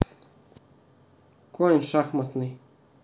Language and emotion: Russian, neutral